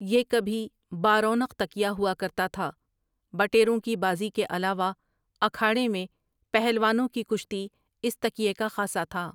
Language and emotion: Urdu, neutral